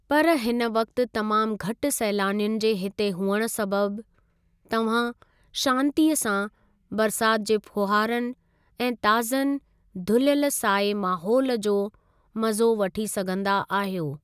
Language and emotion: Sindhi, neutral